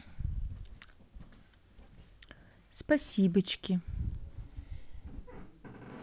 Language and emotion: Russian, neutral